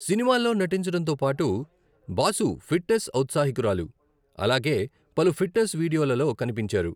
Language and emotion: Telugu, neutral